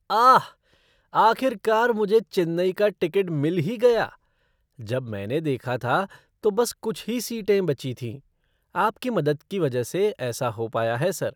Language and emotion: Hindi, surprised